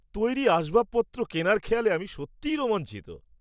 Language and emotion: Bengali, surprised